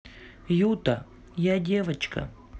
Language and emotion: Russian, neutral